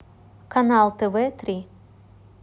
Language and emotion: Russian, neutral